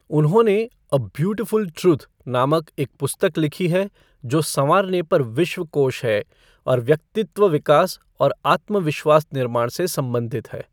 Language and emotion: Hindi, neutral